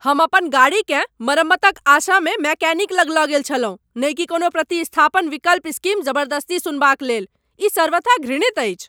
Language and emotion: Maithili, angry